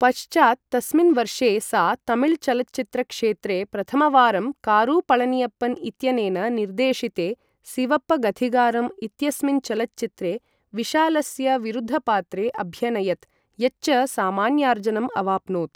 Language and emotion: Sanskrit, neutral